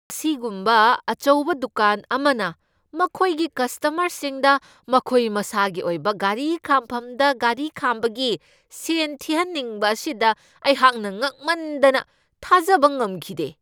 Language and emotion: Manipuri, angry